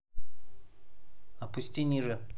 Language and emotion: Russian, neutral